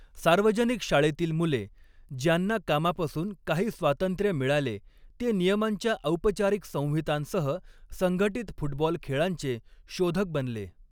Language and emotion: Marathi, neutral